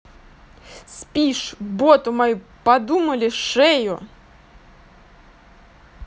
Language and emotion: Russian, angry